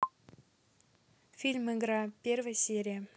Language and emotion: Russian, neutral